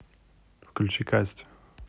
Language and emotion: Russian, neutral